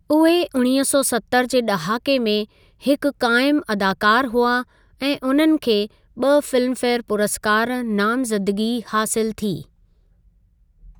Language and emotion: Sindhi, neutral